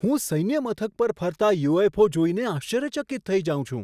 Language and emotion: Gujarati, surprised